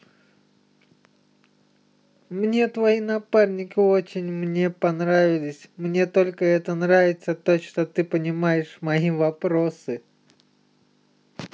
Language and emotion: Russian, positive